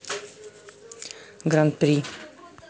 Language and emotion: Russian, neutral